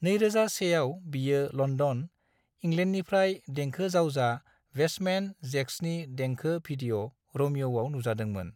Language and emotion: Bodo, neutral